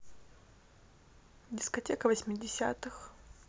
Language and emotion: Russian, neutral